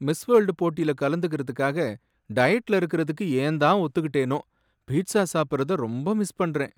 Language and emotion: Tamil, sad